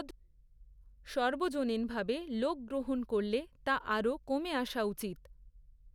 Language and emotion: Bengali, neutral